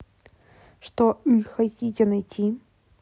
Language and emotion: Russian, neutral